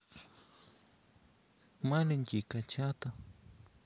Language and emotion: Russian, sad